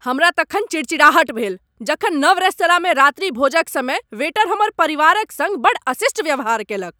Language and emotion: Maithili, angry